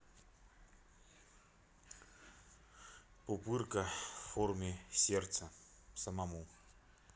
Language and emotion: Russian, neutral